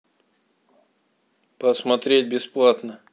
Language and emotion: Russian, neutral